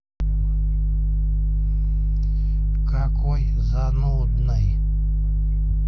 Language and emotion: Russian, neutral